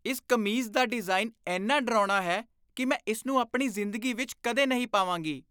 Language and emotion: Punjabi, disgusted